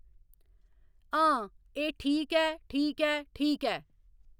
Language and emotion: Dogri, neutral